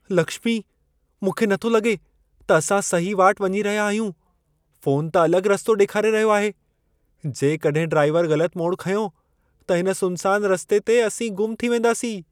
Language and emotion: Sindhi, fearful